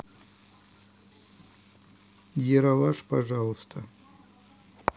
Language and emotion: Russian, neutral